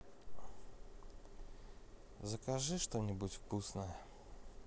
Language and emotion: Russian, neutral